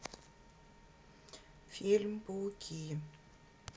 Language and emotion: Russian, neutral